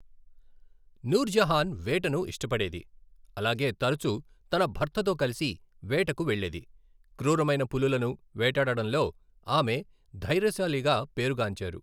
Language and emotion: Telugu, neutral